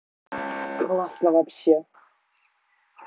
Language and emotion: Russian, positive